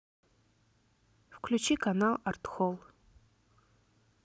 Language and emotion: Russian, neutral